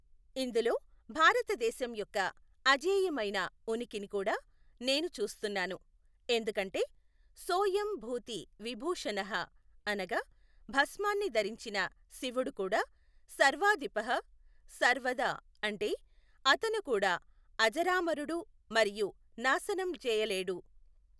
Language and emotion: Telugu, neutral